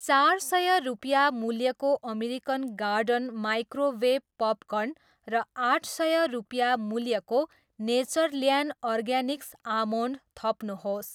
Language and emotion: Nepali, neutral